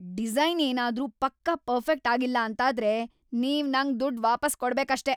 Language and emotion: Kannada, angry